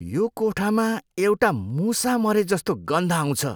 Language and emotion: Nepali, disgusted